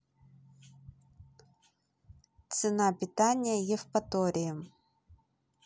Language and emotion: Russian, neutral